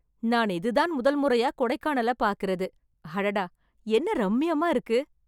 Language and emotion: Tamil, happy